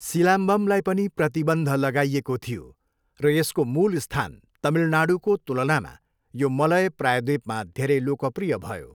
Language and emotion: Nepali, neutral